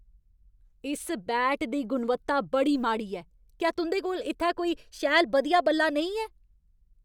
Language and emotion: Dogri, angry